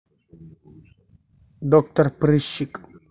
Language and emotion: Russian, neutral